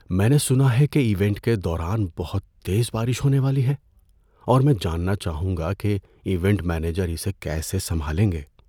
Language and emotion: Urdu, fearful